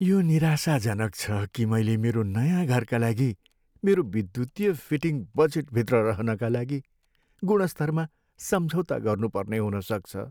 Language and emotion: Nepali, sad